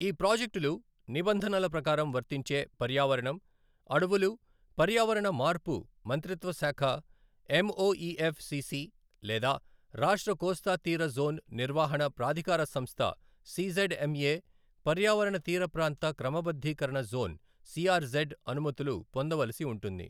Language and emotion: Telugu, neutral